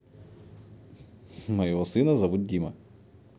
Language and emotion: Russian, neutral